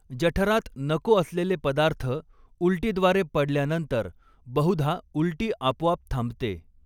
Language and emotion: Marathi, neutral